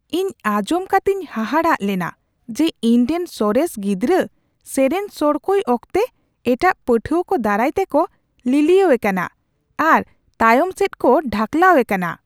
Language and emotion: Santali, surprised